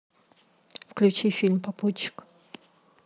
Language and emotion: Russian, neutral